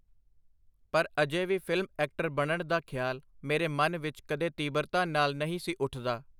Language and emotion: Punjabi, neutral